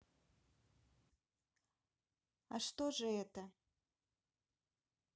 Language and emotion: Russian, neutral